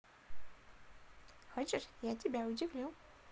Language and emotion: Russian, positive